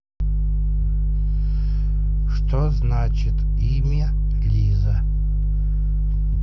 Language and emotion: Russian, neutral